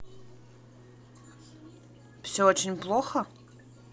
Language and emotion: Russian, neutral